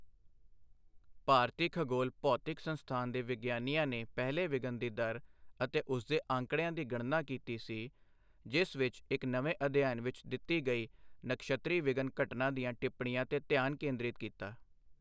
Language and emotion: Punjabi, neutral